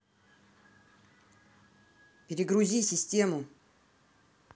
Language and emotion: Russian, angry